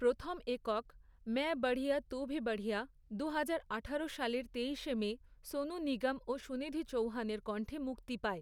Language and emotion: Bengali, neutral